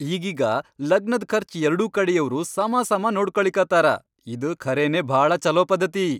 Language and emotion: Kannada, happy